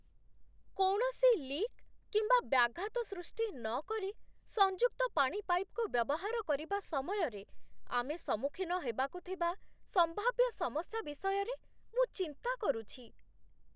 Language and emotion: Odia, fearful